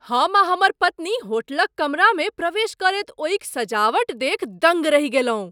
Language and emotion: Maithili, surprised